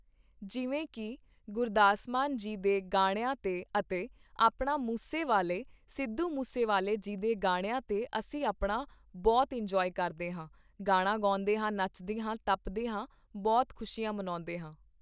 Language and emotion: Punjabi, neutral